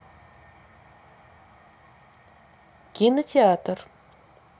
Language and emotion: Russian, neutral